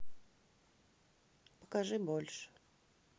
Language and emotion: Russian, neutral